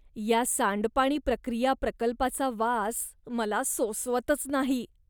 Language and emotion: Marathi, disgusted